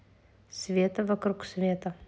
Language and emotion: Russian, neutral